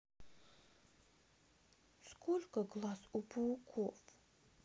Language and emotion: Russian, sad